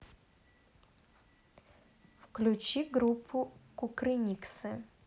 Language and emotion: Russian, neutral